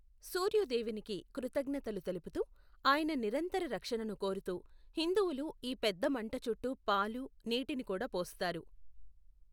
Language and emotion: Telugu, neutral